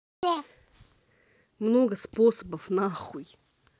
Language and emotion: Russian, angry